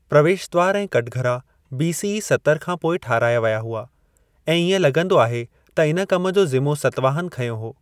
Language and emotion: Sindhi, neutral